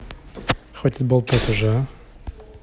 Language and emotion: Russian, angry